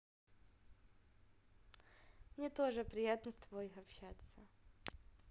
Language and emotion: Russian, positive